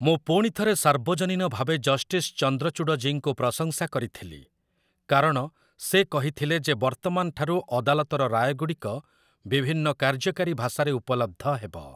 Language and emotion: Odia, neutral